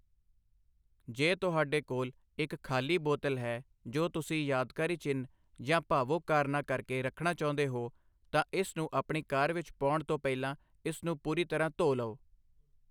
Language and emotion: Punjabi, neutral